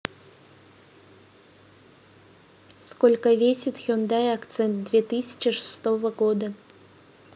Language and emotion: Russian, neutral